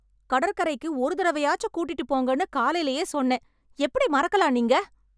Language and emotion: Tamil, angry